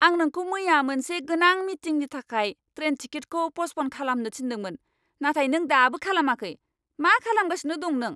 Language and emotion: Bodo, angry